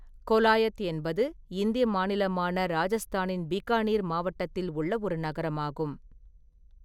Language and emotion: Tamil, neutral